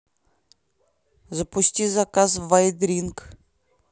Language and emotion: Russian, neutral